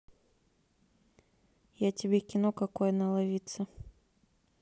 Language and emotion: Russian, neutral